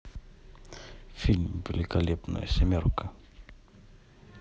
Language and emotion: Russian, neutral